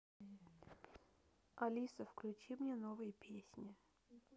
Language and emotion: Russian, neutral